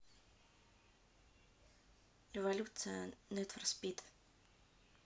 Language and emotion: Russian, neutral